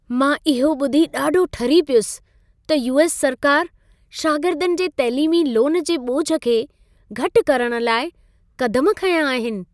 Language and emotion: Sindhi, happy